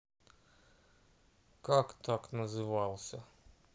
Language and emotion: Russian, neutral